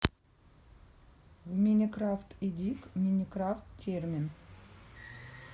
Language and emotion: Russian, neutral